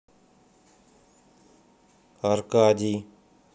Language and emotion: Russian, neutral